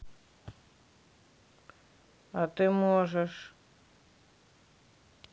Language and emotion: Russian, neutral